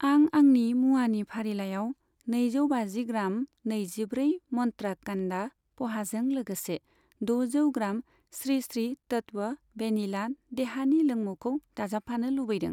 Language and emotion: Bodo, neutral